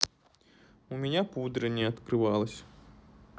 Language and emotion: Russian, sad